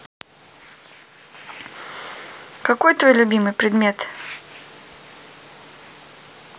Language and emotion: Russian, neutral